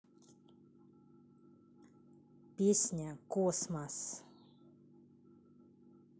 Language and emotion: Russian, neutral